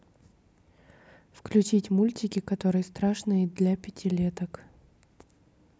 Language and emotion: Russian, neutral